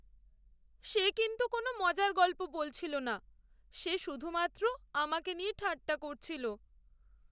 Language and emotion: Bengali, sad